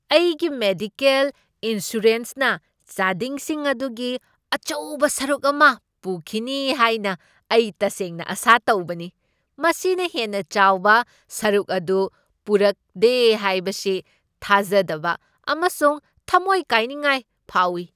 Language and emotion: Manipuri, surprised